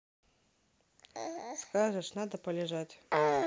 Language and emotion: Russian, neutral